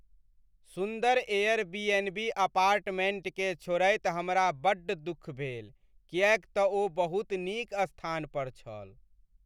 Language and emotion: Maithili, sad